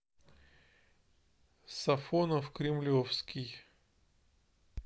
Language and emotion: Russian, neutral